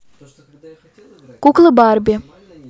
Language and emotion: Russian, neutral